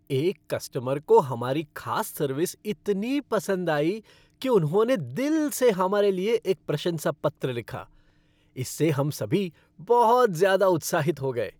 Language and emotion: Hindi, happy